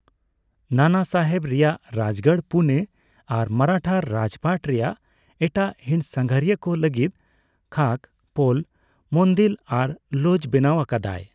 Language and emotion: Santali, neutral